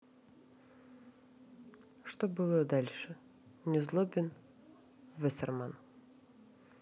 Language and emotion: Russian, neutral